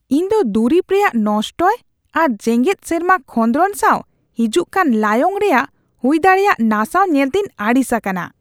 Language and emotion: Santali, disgusted